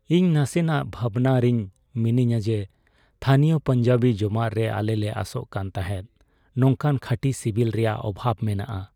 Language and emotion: Santali, sad